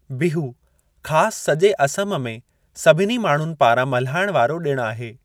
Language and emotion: Sindhi, neutral